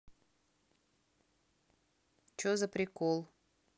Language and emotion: Russian, angry